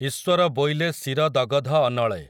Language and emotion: Odia, neutral